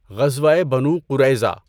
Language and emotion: Urdu, neutral